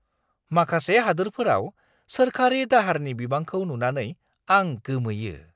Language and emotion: Bodo, surprised